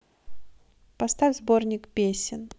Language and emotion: Russian, neutral